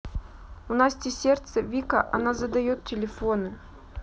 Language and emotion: Russian, sad